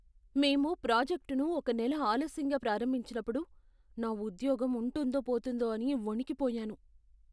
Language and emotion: Telugu, fearful